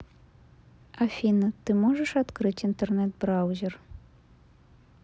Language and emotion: Russian, neutral